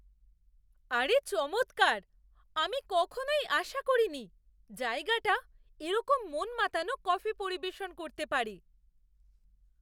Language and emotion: Bengali, surprised